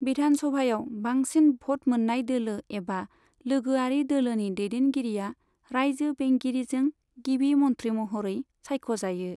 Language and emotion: Bodo, neutral